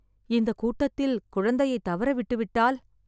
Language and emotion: Tamil, fearful